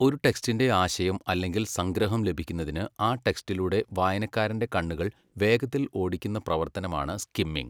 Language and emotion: Malayalam, neutral